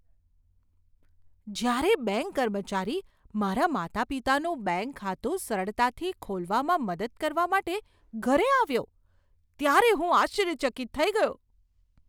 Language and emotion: Gujarati, surprised